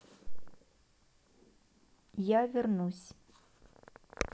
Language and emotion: Russian, neutral